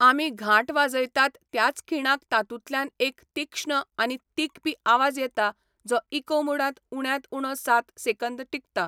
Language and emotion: Goan Konkani, neutral